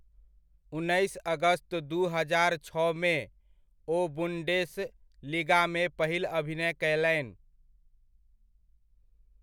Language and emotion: Maithili, neutral